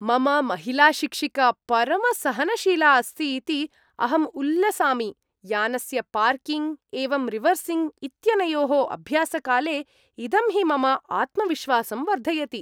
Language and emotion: Sanskrit, happy